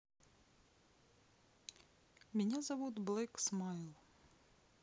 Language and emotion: Russian, neutral